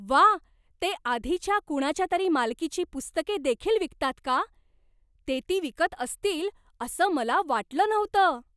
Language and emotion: Marathi, surprised